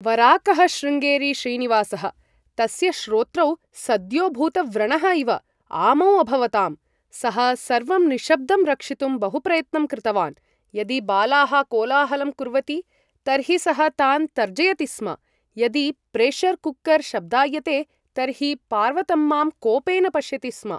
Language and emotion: Sanskrit, neutral